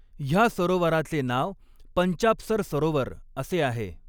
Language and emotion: Marathi, neutral